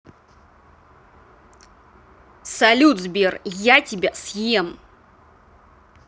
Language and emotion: Russian, angry